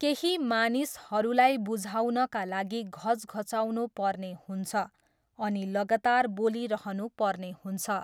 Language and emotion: Nepali, neutral